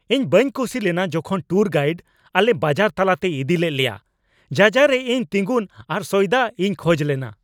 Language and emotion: Santali, angry